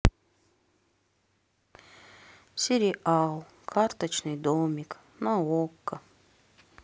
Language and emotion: Russian, sad